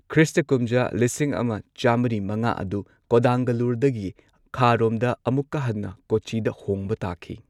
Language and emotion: Manipuri, neutral